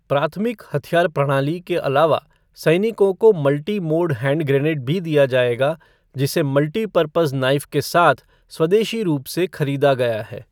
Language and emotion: Hindi, neutral